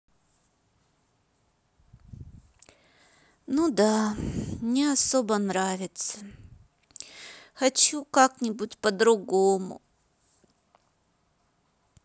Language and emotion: Russian, sad